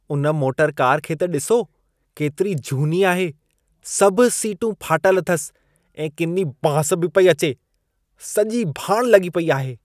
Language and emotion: Sindhi, disgusted